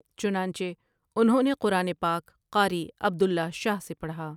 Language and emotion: Urdu, neutral